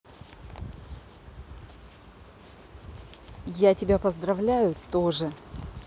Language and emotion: Russian, positive